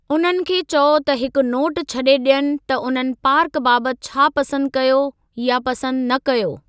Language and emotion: Sindhi, neutral